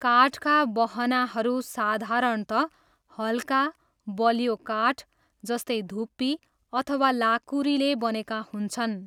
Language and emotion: Nepali, neutral